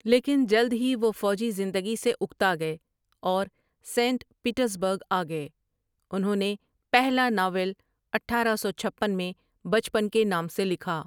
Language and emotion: Urdu, neutral